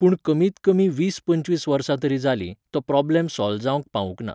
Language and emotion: Goan Konkani, neutral